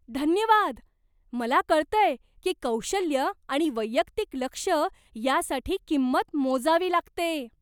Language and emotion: Marathi, surprised